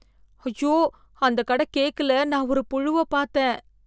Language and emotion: Tamil, disgusted